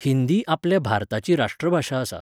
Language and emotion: Goan Konkani, neutral